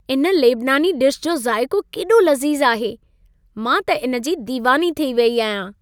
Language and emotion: Sindhi, happy